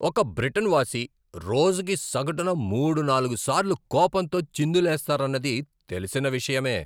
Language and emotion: Telugu, angry